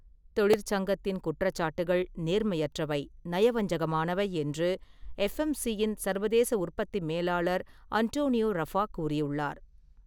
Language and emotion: Tamil, neutral